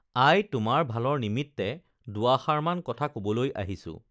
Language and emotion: Assamese, neutral